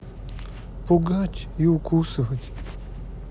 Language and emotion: Russian, sad